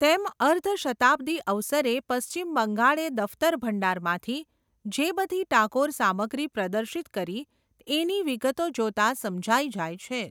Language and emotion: Gujarati, neutral